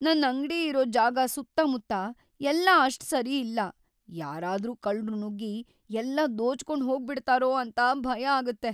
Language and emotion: Kannada, fearful